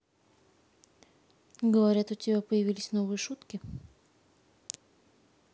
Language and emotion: Russian, neutral